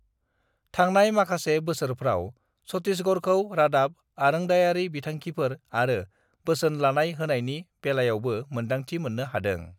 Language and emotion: Bodo, neutral